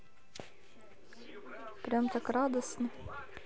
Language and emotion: Russian, neutral